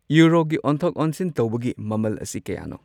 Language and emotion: Manipuri, neutral